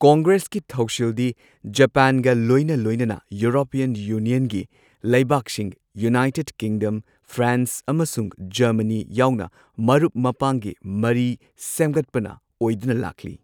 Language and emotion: Manipuri, neutral